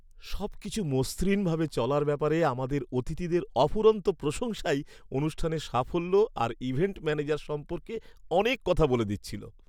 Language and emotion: Bengali, happy